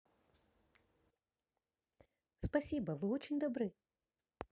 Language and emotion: Russian, positive